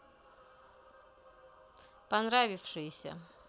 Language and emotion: Russian, neutral